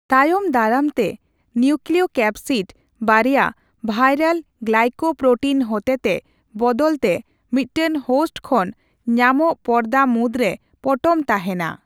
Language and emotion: Santali, neutral